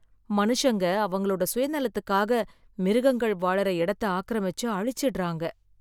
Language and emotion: Tamil, sad